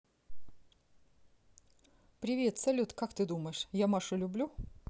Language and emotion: Russian, positive